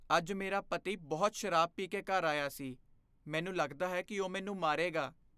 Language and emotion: Punjabi, fearful